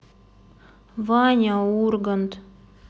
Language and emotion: Russian, sad